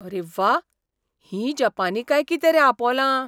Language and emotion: Goan Konkani, surprised